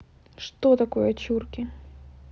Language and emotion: Russian, neutral